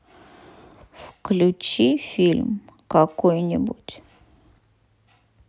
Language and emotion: Russian, sad